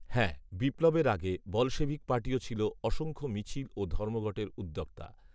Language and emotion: Bengali, neutral